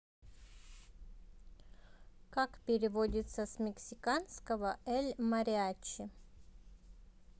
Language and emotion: Russian, neutral